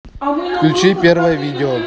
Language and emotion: Russian, neutral